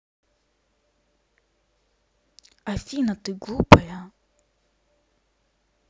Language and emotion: Russian, angry